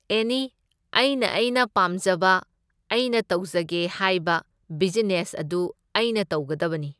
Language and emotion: Manipuri, neutral